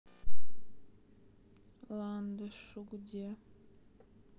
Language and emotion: Russian, sad